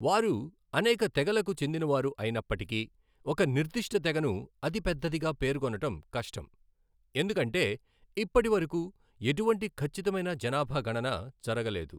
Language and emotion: Telugu, neutral